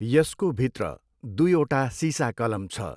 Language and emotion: Nepali, neutral